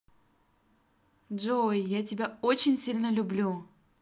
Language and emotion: Russian, positive